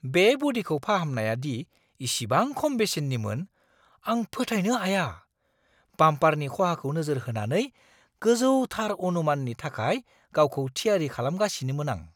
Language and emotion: Bodo, surprised